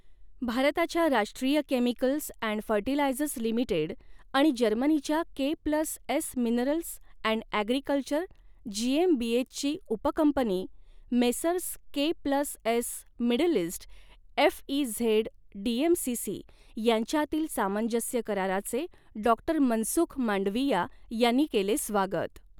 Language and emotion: Marathi, neutral